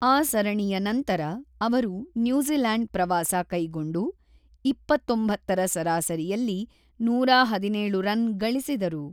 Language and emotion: Kannada, neutral